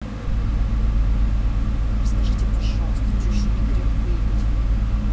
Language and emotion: Russian, angry